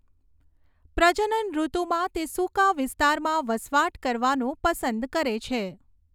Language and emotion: Gujarati, neutral